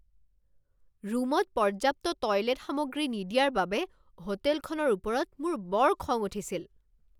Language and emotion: Assamese, angry